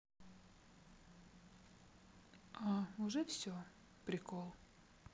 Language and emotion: Russian, neutral